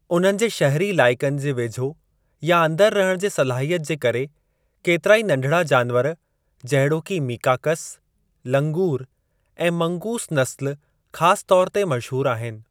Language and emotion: Sindhi, neutral